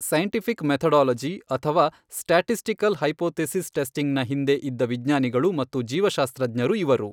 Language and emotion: Kannada, neutral